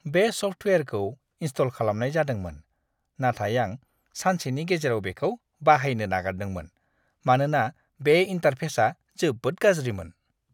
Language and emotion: Bodo, disgusted